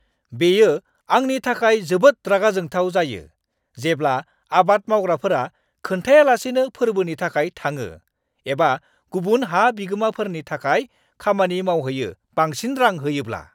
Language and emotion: Bodo, angry